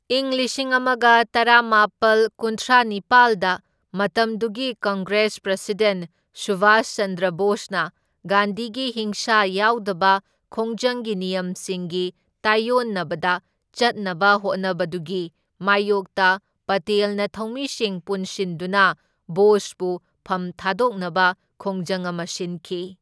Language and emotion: Manipuri, neutral